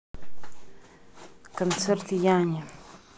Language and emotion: Russian, neutral